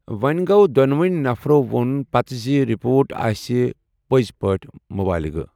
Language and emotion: Kashmiri, neutral